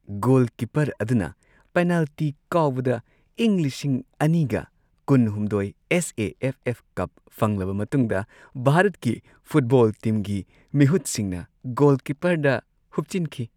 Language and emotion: Manipuri, happy